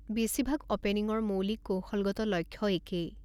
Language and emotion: Assamese, neutral